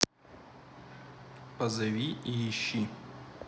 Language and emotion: Russian, neutral